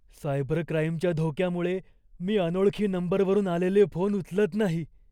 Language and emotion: Marathi, fearful